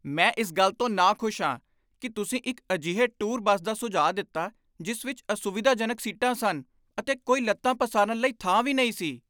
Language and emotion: Punjabi, angry